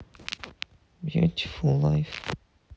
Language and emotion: Russian, sad